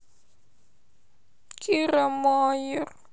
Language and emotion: Russian, sad